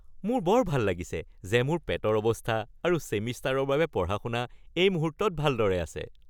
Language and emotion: Assamese, happy